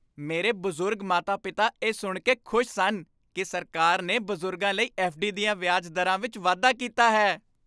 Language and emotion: Punjabi, happy